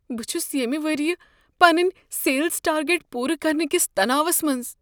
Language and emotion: Kashmiri, fearful